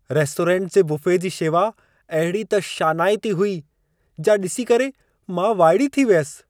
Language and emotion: Sindhi, surprised